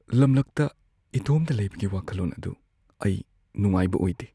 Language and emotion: Manipuri, fearful